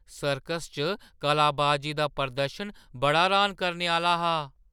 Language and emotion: Dogri, surprised